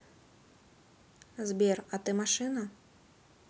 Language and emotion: Russian, neutral